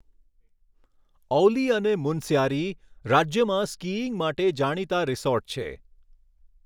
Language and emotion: Gujarati, neutral